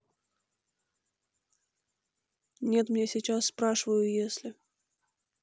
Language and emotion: Russian, neutral